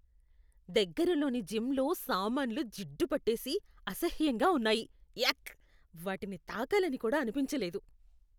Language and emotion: Telugu, disgusted